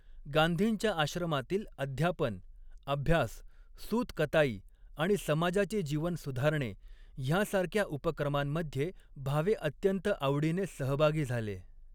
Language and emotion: Marathi, neutral